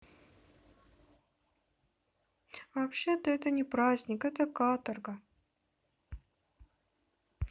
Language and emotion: Russian, sad